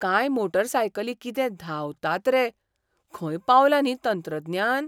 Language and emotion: Goan Konkani, surprised